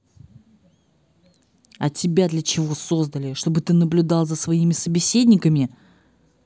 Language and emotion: Russian, angry